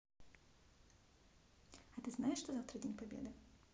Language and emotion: Russian, neutral